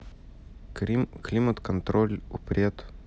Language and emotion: Russian, neutral